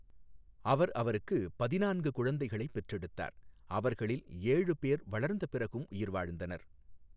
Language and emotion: Tamil, neutral